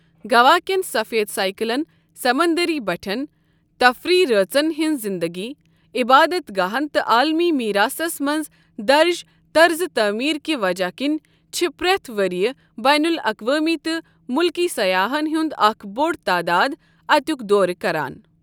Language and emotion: Kashmiri, neutral